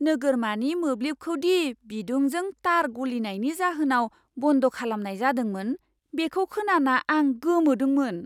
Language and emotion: Bodo, surprised